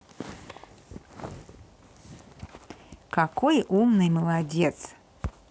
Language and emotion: Russian, positive